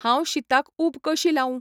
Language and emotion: Goan Konkani, neutral